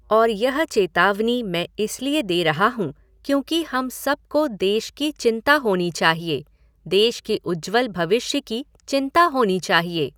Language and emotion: Hindi, neutral